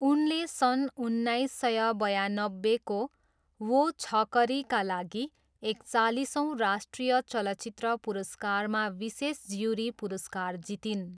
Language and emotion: Nepali, neutral